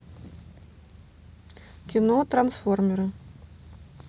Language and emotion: Russian, neutral